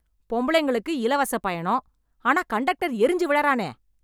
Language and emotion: Tamil, angry